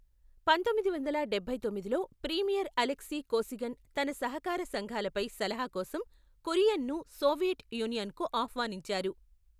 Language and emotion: Telugu, neutral